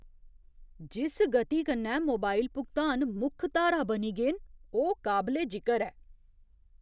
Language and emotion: Dogri, surprised